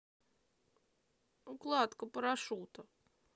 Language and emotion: Russian, sad